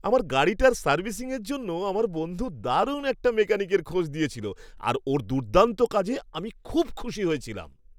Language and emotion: Bengali, happy